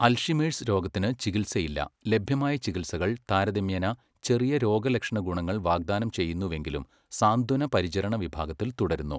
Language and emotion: Malayalam, neutral